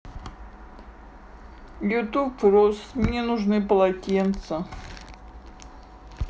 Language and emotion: Russian, sad